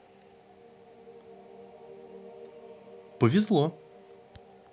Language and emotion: Russian, positive